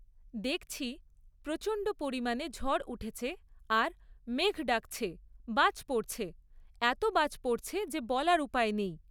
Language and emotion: Bengali, neutral